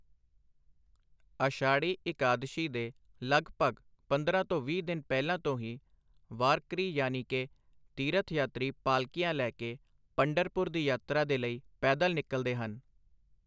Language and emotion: Punjabi, neutral